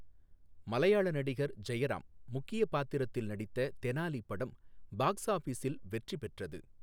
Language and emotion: Tamil, neutral